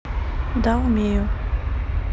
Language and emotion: Russian, neutral